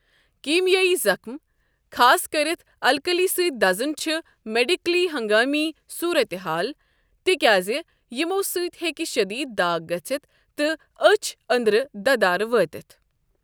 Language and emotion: Kashmiri, neutral